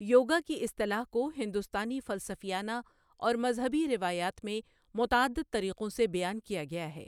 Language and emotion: Urdu, neutral